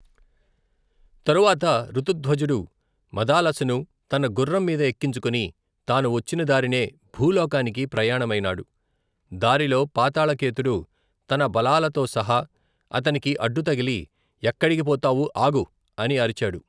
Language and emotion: Telugu, neutral